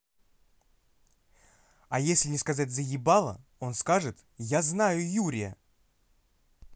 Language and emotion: Russian, angry